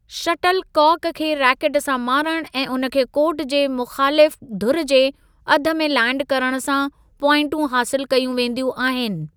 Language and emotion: Sindhi, neutral